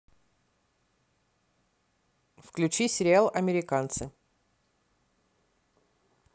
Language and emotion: Russian, neutral